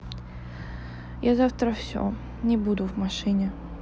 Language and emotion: Russian, sad